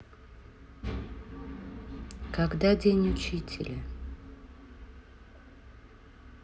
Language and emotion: Russian, neutral